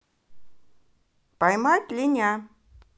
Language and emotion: Russian, positive